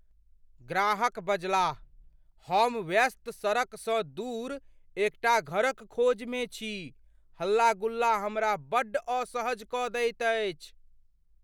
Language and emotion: Maithili, fearful